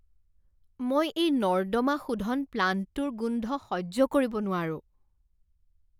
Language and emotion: Assamese, disgusted